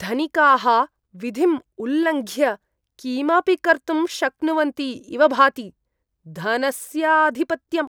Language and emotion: Sanskrit, disgusted